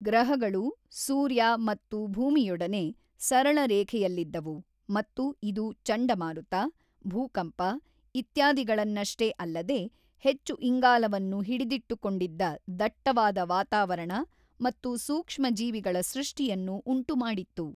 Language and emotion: Kannada, neutral